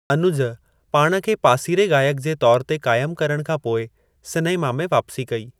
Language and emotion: Sindhi, neutral